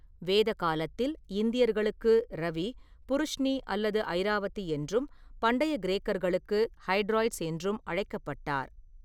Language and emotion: Tamil, neutral